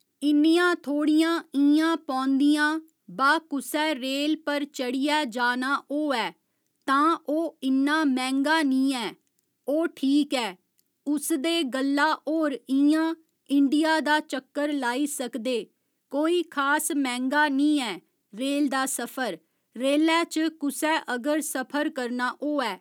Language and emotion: Dogri, neutral